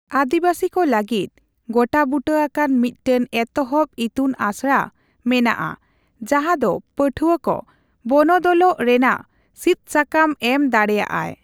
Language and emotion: Santali, neutral